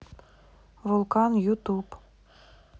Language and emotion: Russian, neutral